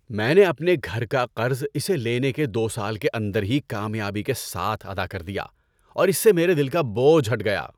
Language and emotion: Urdu, happy